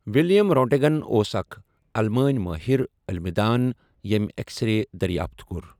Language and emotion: Kashmiri, neutral